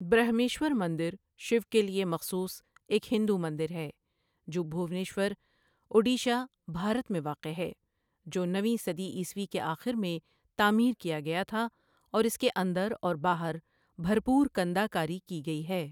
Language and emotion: Urdu, neutral